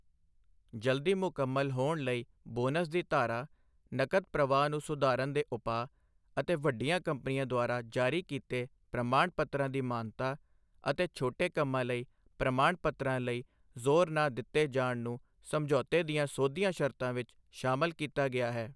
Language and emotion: Punjabi, neutral